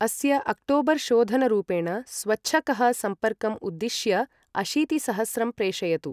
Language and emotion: Sanskrit, neutral